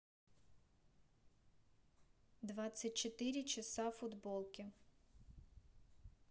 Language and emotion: Russian, neutral